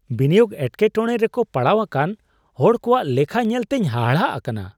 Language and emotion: Santali, surprised